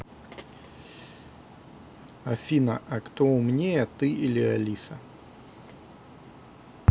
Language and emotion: Russian, neutral